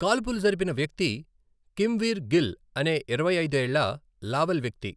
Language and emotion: Telugu, neutral